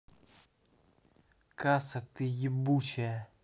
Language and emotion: Russian, angry